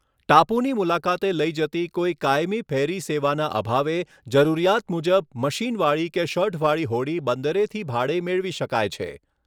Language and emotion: Gujarati, neutral